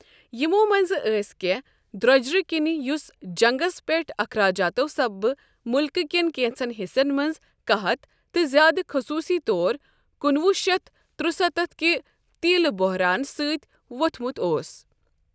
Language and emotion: Kashmiri, neutral